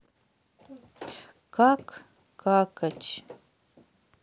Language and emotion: Russian, sad